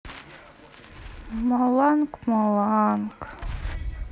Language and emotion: Russian, sad